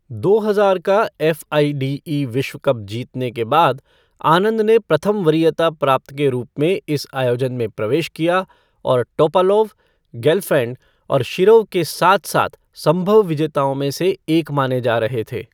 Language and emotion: Hindi, neutral